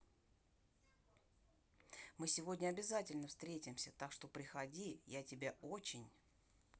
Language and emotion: Russian, positive